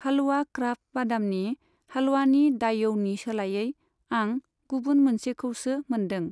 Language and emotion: Bodo, neutral